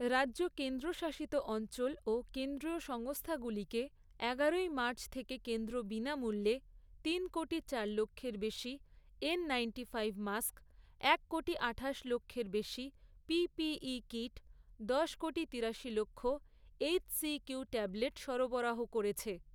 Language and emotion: Bengali, neutral